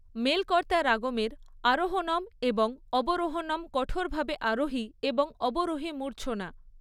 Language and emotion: Bengali, neutral